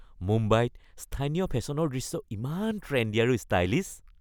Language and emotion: Assamese, happy